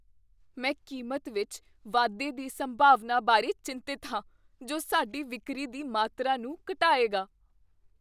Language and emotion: Punjabi, fearful